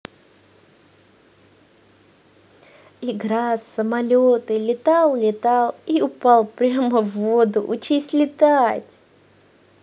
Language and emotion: Russian, positive